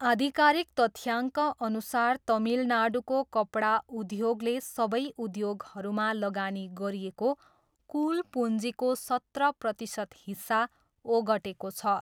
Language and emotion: Nepali, neutral